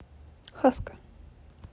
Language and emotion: Russian, neutral